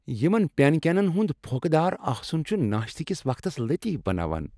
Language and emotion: Kashmiri, happy